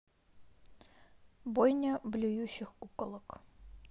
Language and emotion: Russian, neutral